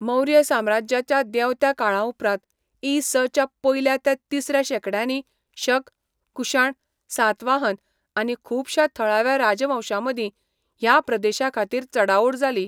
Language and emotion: Goan Konkani, neutral